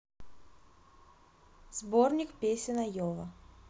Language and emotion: Russian, neutral